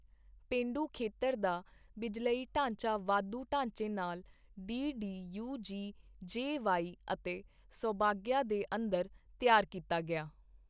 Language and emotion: Punjabi, neutral